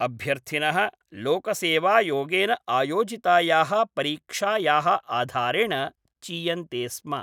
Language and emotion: Sanskrit, neutral